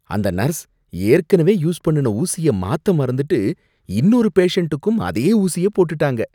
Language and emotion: Tamil, disgusted